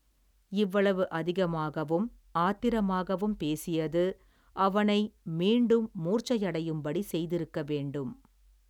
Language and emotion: Tamil, neutral